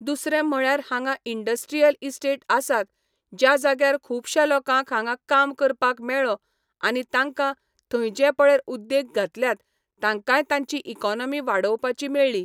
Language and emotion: Goan Konkani, neutral